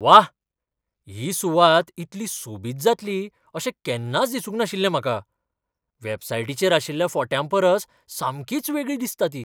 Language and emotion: Goan Konkani, surprised